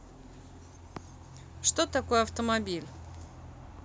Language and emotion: Russian, neutral